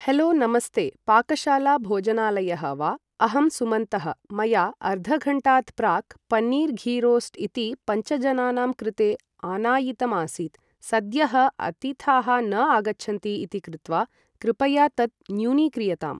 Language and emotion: Sanskrit, neutral